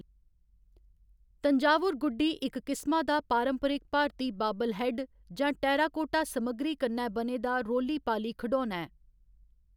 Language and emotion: Dogri, neutral